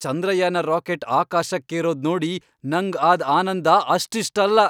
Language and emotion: Kannada, happy